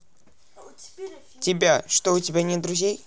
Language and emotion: Russian, neutral